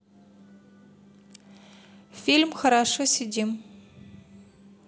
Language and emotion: Russian, neutral